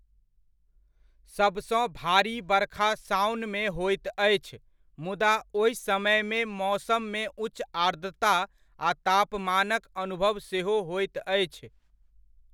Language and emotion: Maithili, neutral